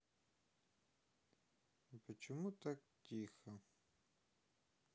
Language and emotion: Russian, sad